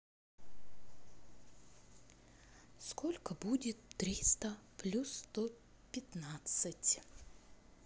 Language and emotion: Russian, neutral